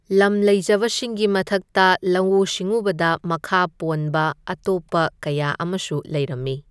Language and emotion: Manipuri, neutral